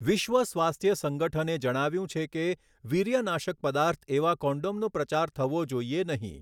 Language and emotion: Gujarati, neutral